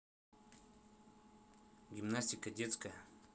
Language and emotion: Russian, neutral